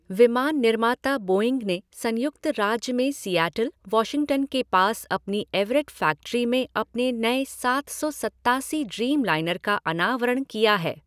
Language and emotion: Hindi, neutral